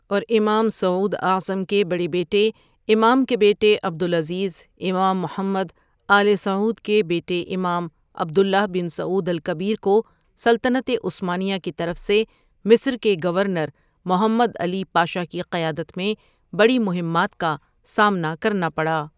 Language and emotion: Urdu, neutral